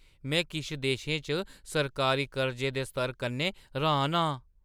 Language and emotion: Dogri, surprised